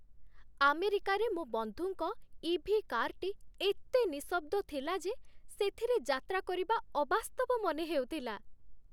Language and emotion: Odia, happy